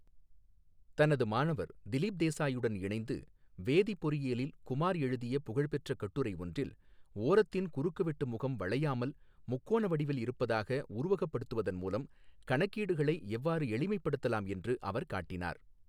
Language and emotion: Tamil, neutral